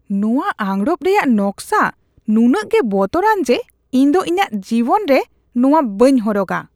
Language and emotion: Santali, disgusted